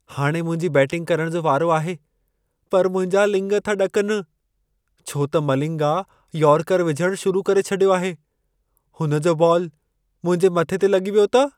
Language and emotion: Sindhi, fearful